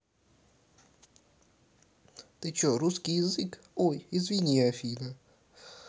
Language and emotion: Russian, neutral